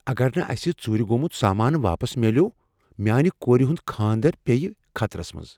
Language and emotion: Kashmiri, fearful